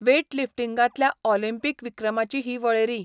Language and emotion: Goan Konkani, neutral